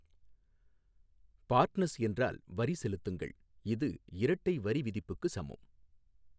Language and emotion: Tamil, neutral